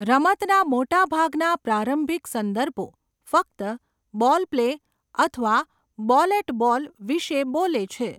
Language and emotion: Gujarati, neutral